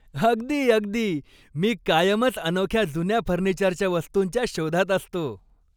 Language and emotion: Marathi, happy